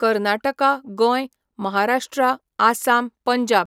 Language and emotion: Goan Konkani, neutral